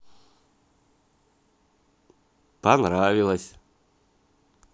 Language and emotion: Russian, positive